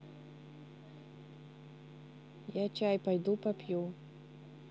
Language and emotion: Russian, neutral